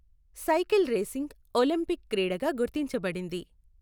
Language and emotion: Telugu, neutral